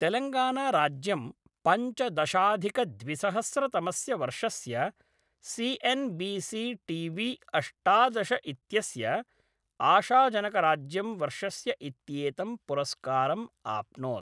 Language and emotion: Sanskrit, neutral